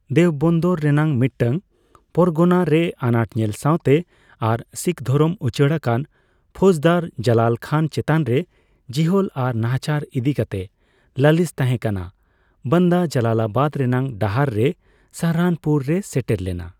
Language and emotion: Santali, neutral